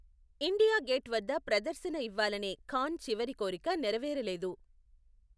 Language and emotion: Telugu, neutral